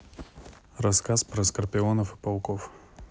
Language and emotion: Russian, neutral